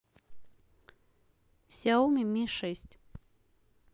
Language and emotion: Russian, neutral